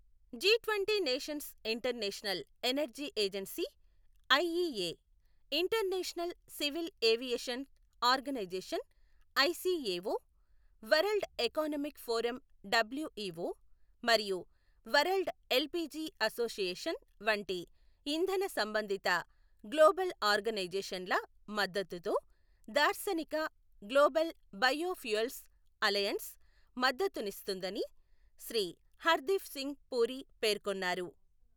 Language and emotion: Telugu, neutral